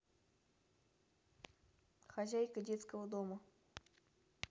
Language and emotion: Russian, neutral